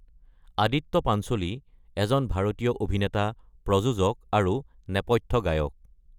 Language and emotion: Assamese, neutral